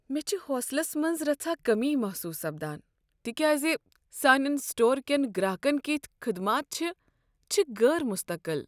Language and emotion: Kashmiri, sad